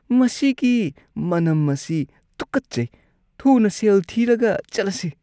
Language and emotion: Manipuri, disgusted